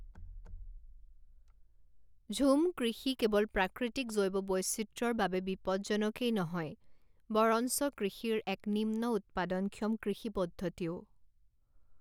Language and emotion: Assamese, neutral